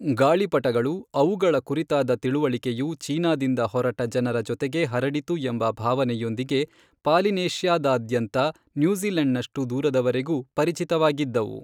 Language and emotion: Kannada, neutral